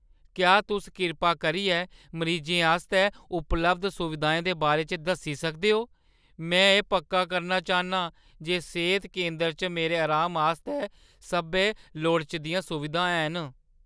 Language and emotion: Dogri, fearful